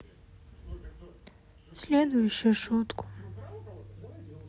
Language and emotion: Russian, sad